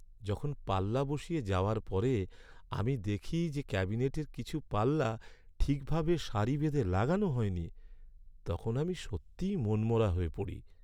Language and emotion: Bengali, sad